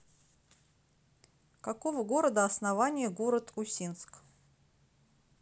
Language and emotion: Russian, neutral